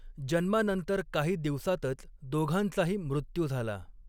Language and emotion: Marathi, neutral